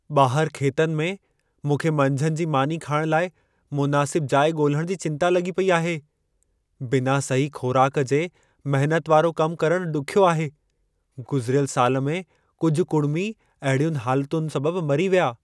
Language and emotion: Sindhi, fearful